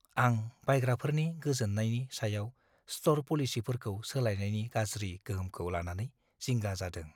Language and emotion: Bodo, fearful